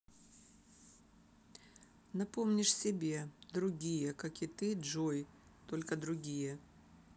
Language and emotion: Russian, neutral